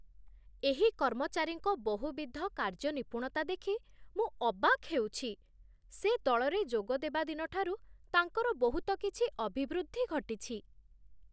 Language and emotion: Odia, surprised